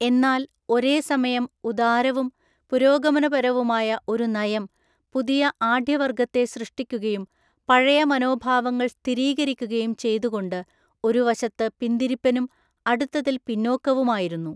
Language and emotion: Malayalam, neutral